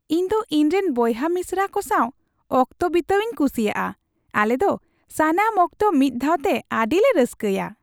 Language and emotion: Santali, happy